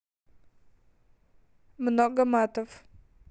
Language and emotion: Russian, neutral